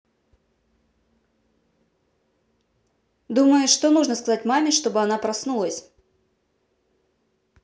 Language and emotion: Russian, neutral